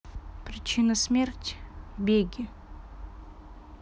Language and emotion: Russian, sad